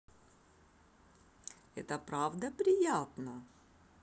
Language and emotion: Russian, positive